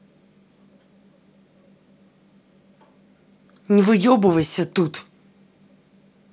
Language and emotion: Russian, angry